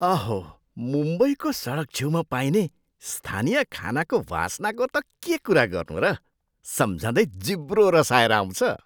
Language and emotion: Nepali, surprised